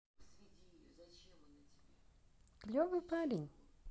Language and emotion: Russian, neutral